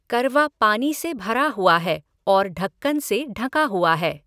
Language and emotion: Hindi, neutral